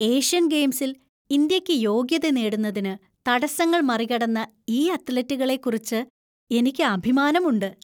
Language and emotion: Malayalam, happy